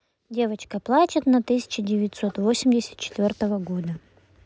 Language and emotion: Russian, neutral